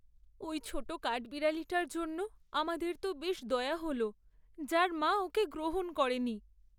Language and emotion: Bengali, sad